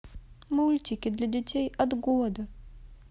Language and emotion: Russian, sad